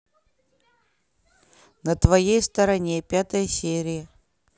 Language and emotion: Russian, neutral